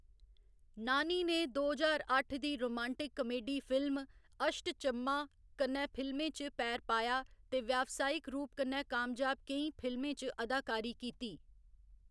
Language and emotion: Dogri, neutral